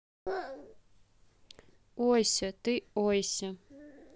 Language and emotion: Russian, neutral